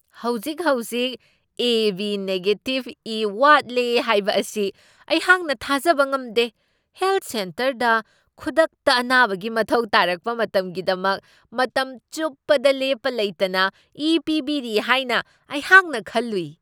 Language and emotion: Manipuri, surprised